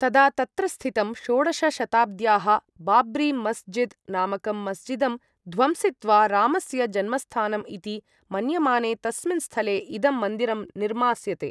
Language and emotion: Sanskrit, neutral